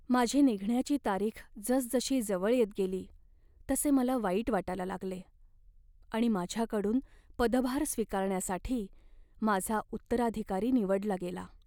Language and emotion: Marathi, sad